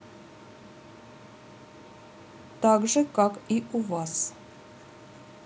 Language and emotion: Russian, neutral